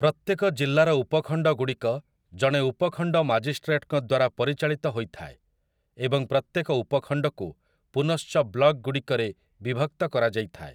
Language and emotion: Odia, neutral